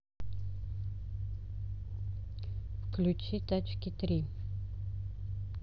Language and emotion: Russian, neutral